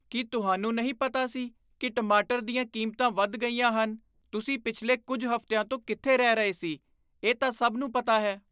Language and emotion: Punjabi, disgusted